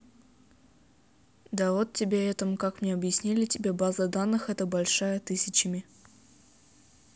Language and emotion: Russian, neutral